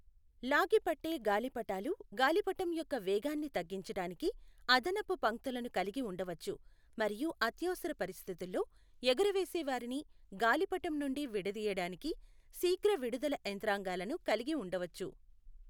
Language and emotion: Telugu, neutral